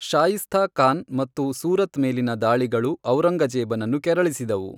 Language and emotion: Kannada, neutral